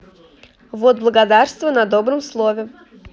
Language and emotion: Russian, positive